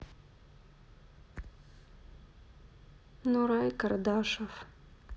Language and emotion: Russian, sad